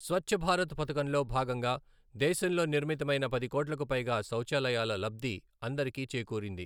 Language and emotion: Telugu, neutral